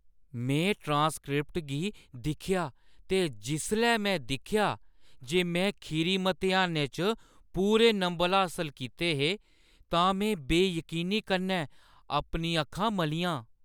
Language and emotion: Dogri, surprised